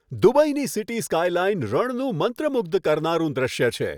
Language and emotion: Gujarati, happy